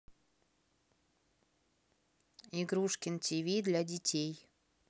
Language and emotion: Russian, neutral